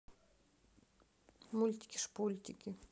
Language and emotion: Russian, neutral